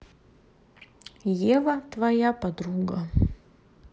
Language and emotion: Russian, neutral